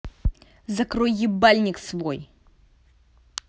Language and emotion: Russian, angry